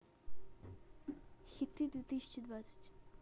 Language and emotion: Russian, neutral